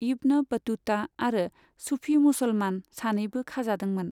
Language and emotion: Bodo, neutral